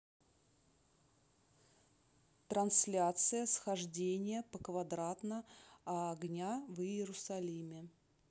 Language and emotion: Russian, neutral